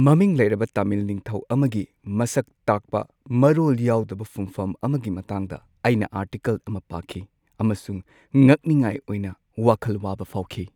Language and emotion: Manipuri, sad